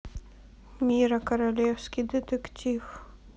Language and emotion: Russian, sad